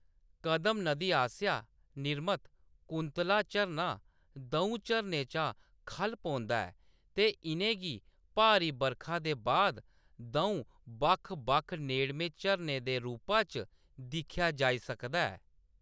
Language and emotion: Dogri, neutral